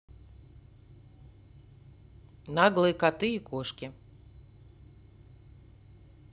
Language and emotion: Russian, neutral